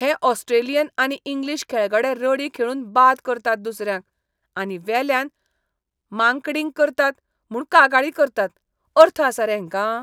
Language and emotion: Goan Konkani, disgusted